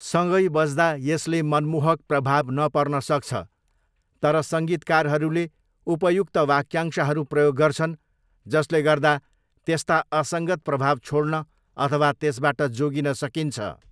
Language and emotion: Nepali, neutral